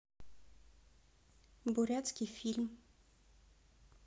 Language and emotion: Russian, neutral